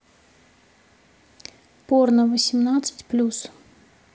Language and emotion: Russian, neutral